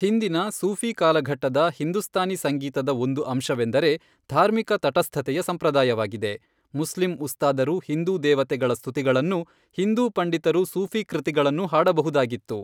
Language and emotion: Kannada, neutral